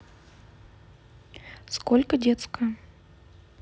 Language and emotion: Russian, neutral